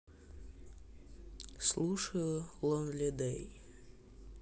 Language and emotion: Russian, sad